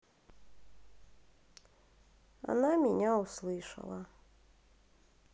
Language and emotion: Russian, sad